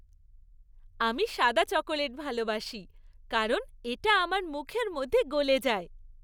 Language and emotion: Bengali, happy